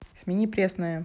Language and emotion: Russian, neutral